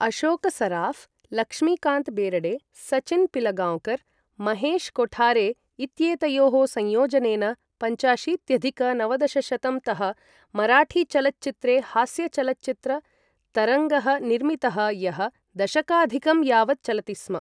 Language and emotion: Sanskrit, neutral